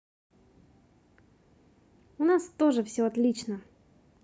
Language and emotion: Russian, positive